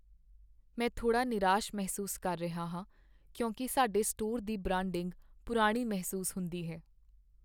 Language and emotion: Punjabi, sad